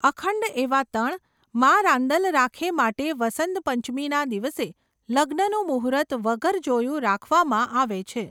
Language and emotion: Gujarati, neutral